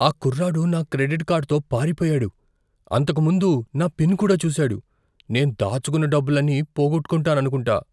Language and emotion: Telugu, fearful